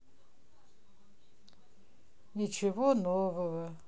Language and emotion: Russian, sad